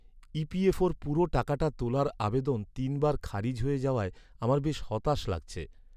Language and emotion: Bengali, sad